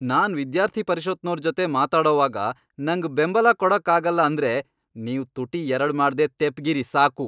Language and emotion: Kannada, angry